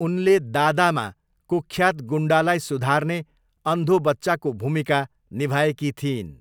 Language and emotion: Nepali, neutral